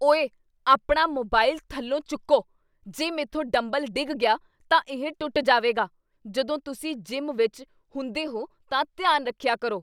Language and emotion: Punjabi, angry